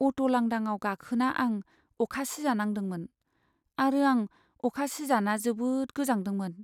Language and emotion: Bodo, sad